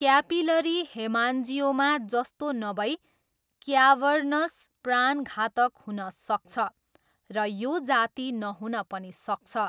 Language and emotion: Nepali, neutral